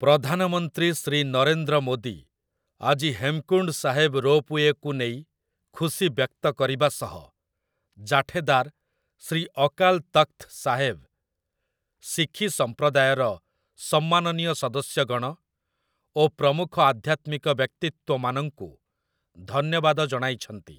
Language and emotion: Odia, neutral